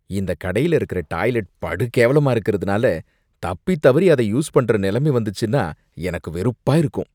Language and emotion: Tamil, disgusted